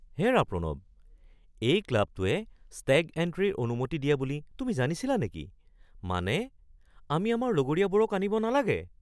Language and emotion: Assamese, surprised